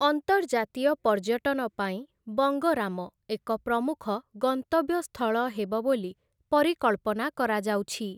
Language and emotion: Odia, neutral